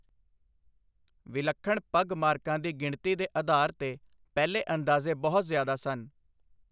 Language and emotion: Punjabi, neutral